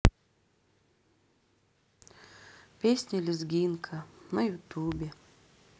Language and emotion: Russian, sad